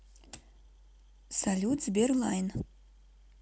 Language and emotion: Russian, neutral